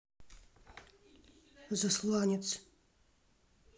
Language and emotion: Russian, neutral